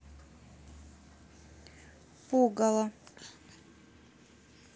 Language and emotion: Russian, neutral